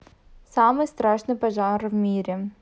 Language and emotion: Russian, neutral